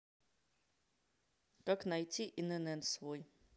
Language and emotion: Russian, neutral